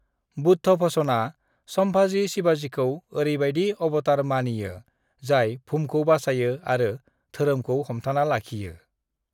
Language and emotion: Bodo, neutral